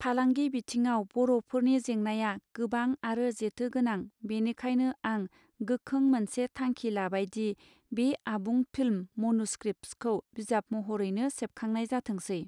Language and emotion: Bodo, neutral